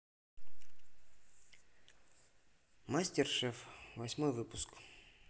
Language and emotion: Russian, neutral